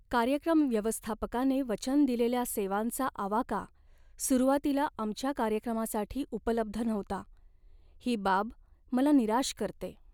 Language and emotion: Marathi, sad